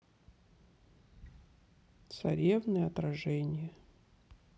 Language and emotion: Russian, sad